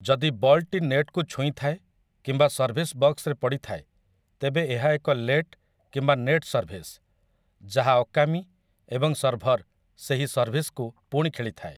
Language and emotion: Odia, neutral